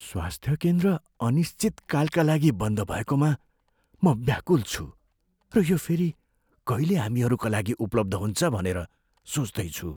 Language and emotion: Nepali, fearful